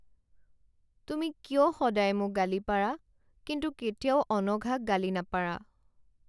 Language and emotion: Assamese, sad